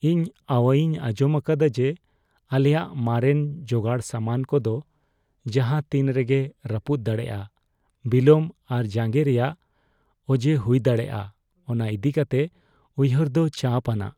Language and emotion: Santali, fearful